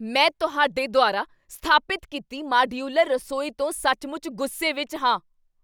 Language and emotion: Punjabi, angry